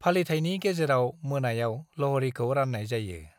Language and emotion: Bodo, neutral